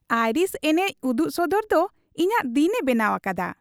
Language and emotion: Santali, happy